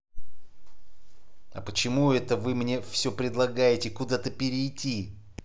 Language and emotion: Russian, angry